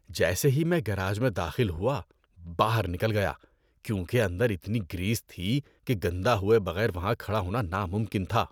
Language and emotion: Urdu, disgusted